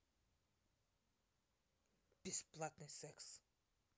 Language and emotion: Russian, neutral